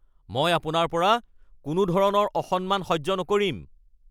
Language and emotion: Assamese, angry